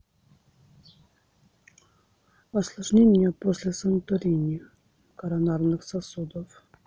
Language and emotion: Russian, neutral